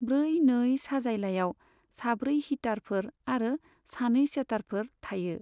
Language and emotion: Bodo, neutral